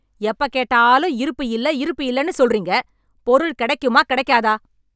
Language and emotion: Tamil, angry